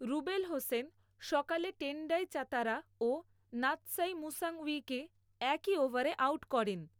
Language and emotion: Bengali, neutral